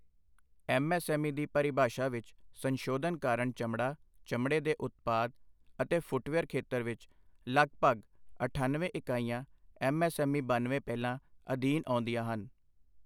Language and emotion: Punjabi, neutral